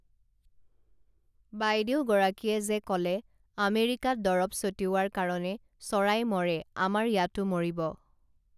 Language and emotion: Assamese, neutral